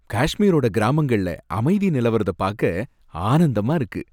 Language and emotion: Tamil, happy